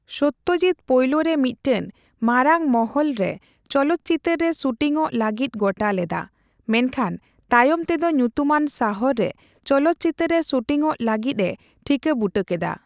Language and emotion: Santali, neutral